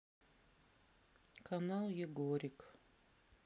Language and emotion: Russian, sad